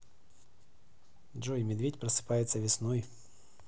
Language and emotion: Russian, neutral